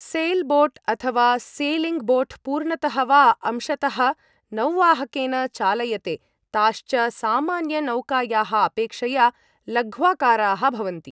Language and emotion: Sanskrit, neutral